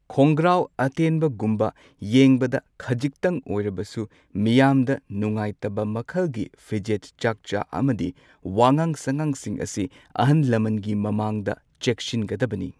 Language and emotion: Manipuri, neutral